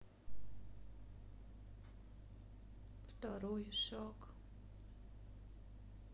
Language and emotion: Russian, sad